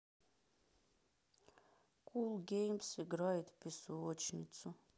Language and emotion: Russian, sad